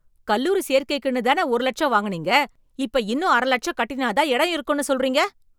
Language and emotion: Tamil, angry